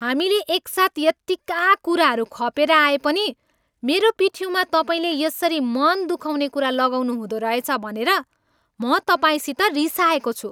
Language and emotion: Nepali, angry